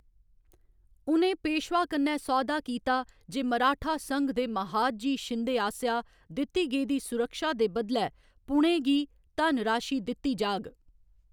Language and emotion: Dogri, neutral